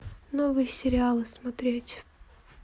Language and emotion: Russian, sad